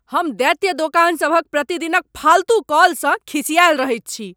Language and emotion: Maithili, angry